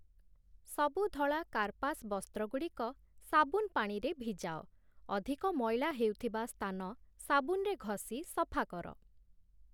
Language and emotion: Odia, neutral